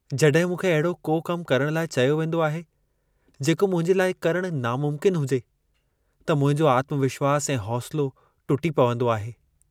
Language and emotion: Sindhi, sad